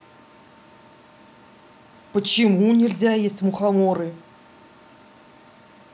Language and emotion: Russian, angry